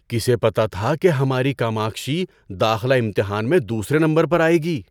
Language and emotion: Urdu, surprised